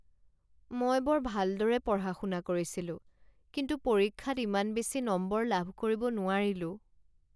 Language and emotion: Assamese, sad